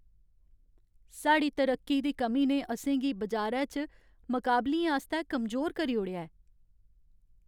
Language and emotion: Dogri, sad